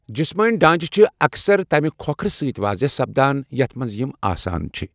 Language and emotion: Kashmiri, neutral